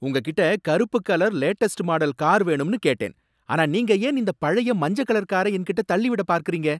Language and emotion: Tamil, angry